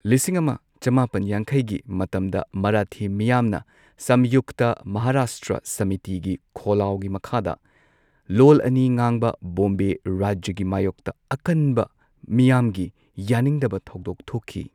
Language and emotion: Manipuri, neutral